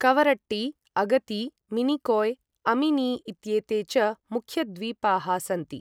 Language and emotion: Sanskrit, neutral